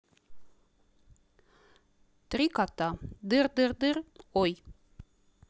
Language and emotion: Russian, neutral